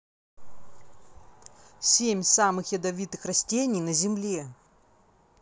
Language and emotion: Russian, neutral